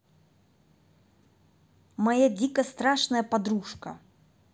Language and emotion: Russian, angry